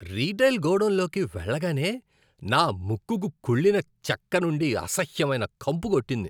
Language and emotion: Telugu, disgusted